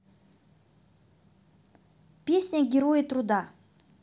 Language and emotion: Russian, positive